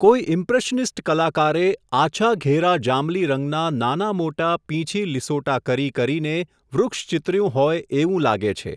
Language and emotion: Gujarati, neutral